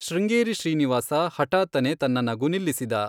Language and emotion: Kannada, neutral